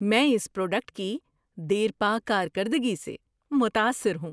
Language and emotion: Urdu, surprised